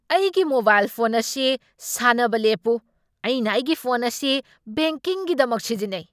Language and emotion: Manipuri, angry